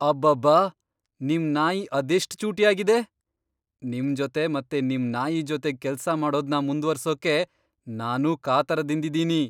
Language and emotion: Kannada, surprised